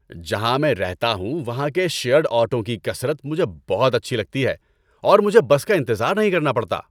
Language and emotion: Urdu, happy